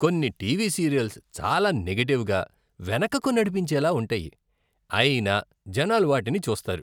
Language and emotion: Telugu, disgusted